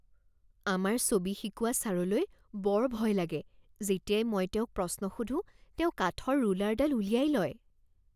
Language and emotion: Assamese, fearful